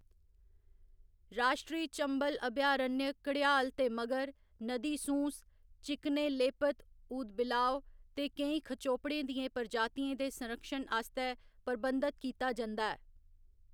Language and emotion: Dogri, neutral